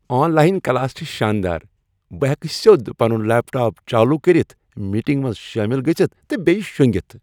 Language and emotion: Kashmiri, happy